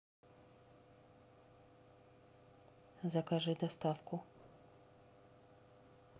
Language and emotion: Russian, neutral